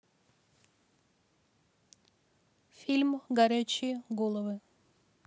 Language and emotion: Russian, neutral